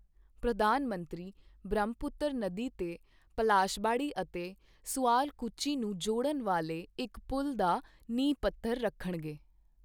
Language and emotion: Punjabi, neutral